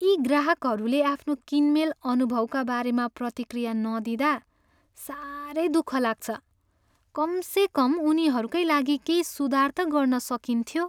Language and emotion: Nepali, sad